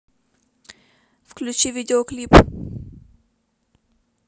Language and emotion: Russian, neutral